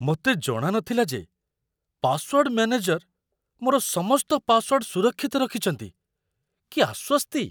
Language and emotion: Odia, surprised